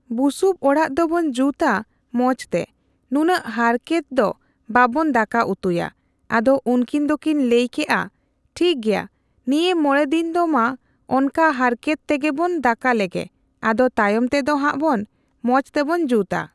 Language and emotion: Santali, neutral